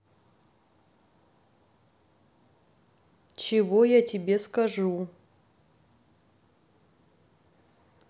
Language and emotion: Russian, neutral